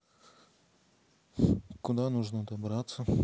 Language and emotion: Russian, neutral